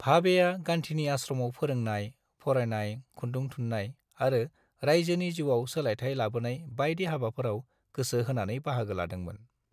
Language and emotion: Bodo, neutral